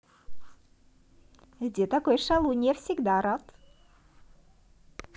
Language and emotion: Russian, positive